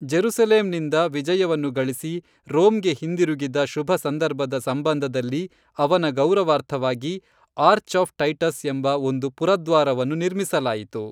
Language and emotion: Kannada, neutral